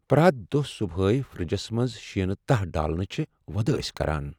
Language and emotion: Kashmiri, sad